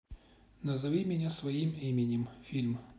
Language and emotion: Russian, neutral